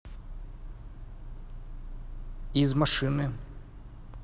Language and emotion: Russian, neutral